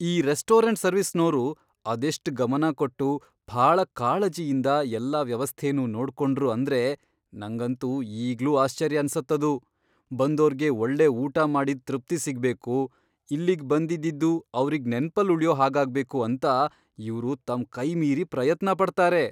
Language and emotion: Kannada, surprised